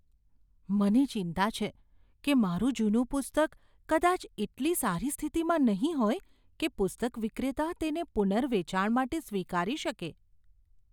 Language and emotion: Gujarati, fearful